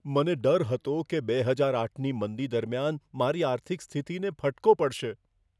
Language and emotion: Gujarati, fearful